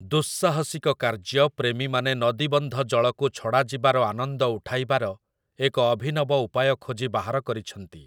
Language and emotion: Odia, neutral